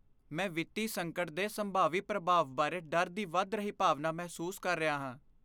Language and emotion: Punjabi, fearful